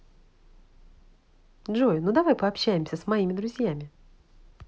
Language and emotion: Russian, positive